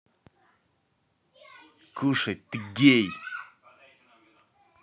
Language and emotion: Russian, angry